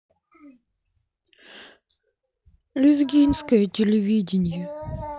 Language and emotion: Russian, sad